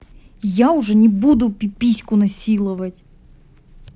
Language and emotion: Russian, angry